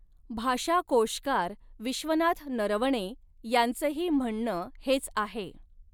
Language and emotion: Marathi, neutral